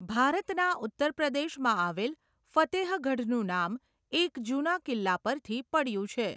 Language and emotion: Gujarati, neutral